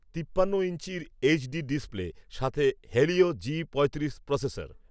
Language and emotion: Bengali, neutral